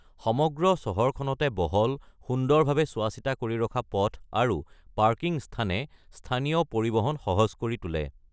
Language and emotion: Assamese, neutral